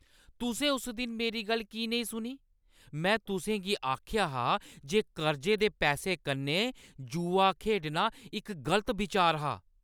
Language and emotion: Dogri, angry